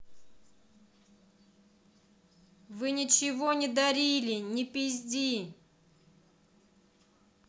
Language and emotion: Russian, angry